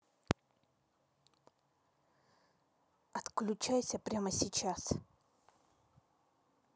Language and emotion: Russian, angry